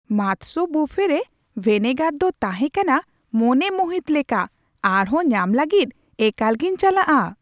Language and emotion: Santali, surprised